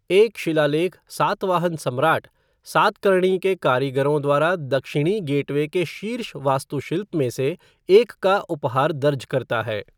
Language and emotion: Hindi, neutral